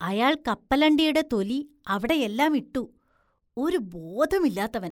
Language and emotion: Malayalam, disgusted